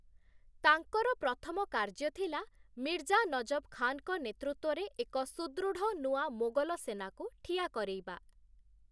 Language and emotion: Odia, neutral